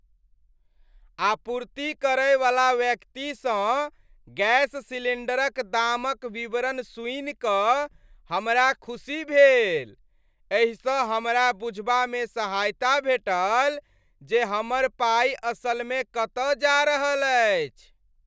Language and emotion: Maithili, happy